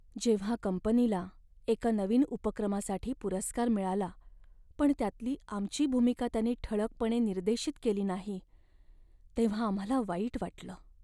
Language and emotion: Marathi, sad